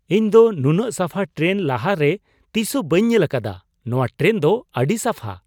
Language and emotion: Santali, surprised